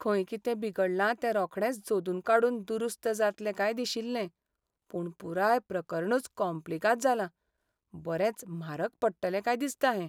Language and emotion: Goan Konkani, sad